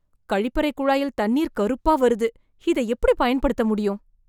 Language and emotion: Tamil, disgusted